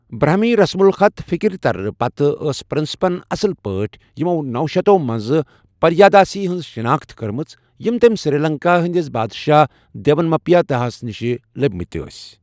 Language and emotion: Kashmiri, neutral